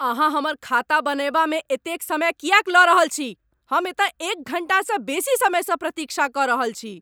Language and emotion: Maithili, angry